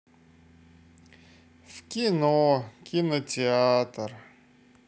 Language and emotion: Russian, sad